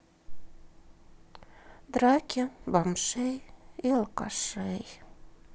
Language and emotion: Russian, sad